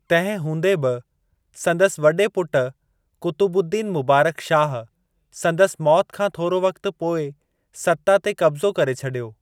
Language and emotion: Sindhi, neutral